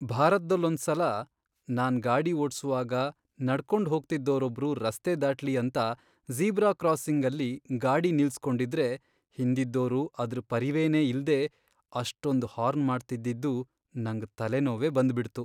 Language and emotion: Kannada, sad